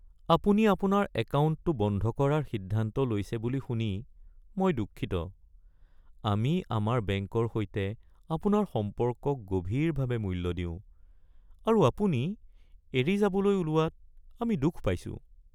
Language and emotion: Assamese, sad